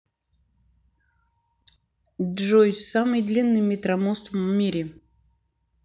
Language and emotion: Russian, neutral